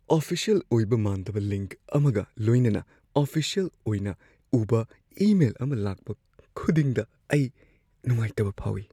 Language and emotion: Manipuri, fearful